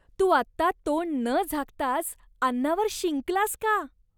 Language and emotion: Marathi, disgusted